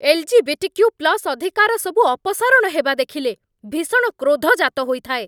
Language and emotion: Odia, angry